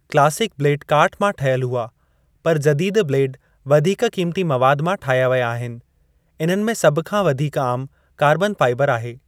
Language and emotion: Sindhi, neutral